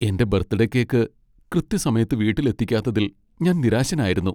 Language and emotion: Malayalam, sad